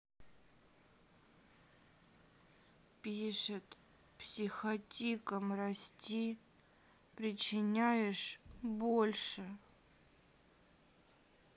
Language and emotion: Russian, sad